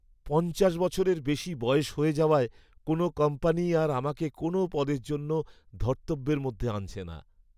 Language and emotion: Bengali, sad